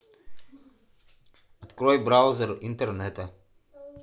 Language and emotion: Russian, neutral